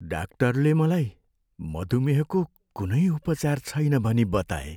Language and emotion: Nepali, sad